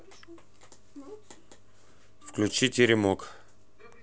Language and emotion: Russian, neutral